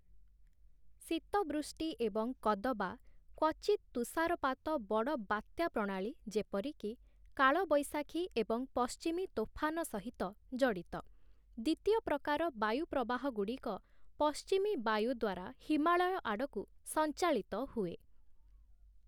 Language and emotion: Odia, neutral